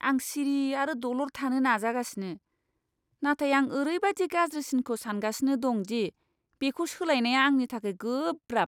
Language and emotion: Bodo, disgusted